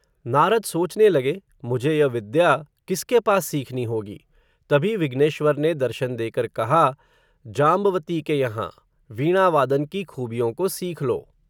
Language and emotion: Hindi, neutral